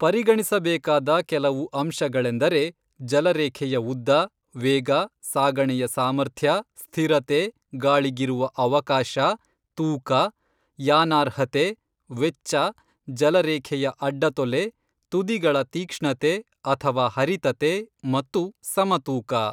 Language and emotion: Kannada, neutral